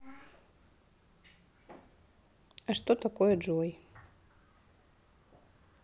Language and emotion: Russian, neutral